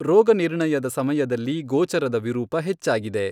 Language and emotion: Kannada, neutral